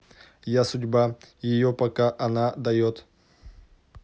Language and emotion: Russian, neutral